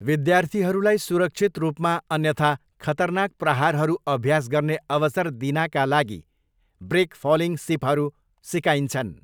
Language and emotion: Nepali, neutral